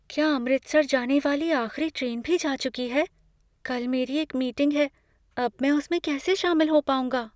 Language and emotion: Hindi, fearful